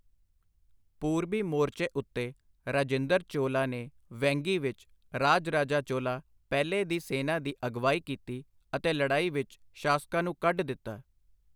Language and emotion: Punjabi, neutral